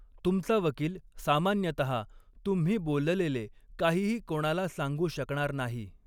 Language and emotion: Marathi, neutral